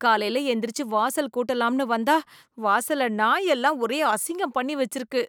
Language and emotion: Tamil, disgusted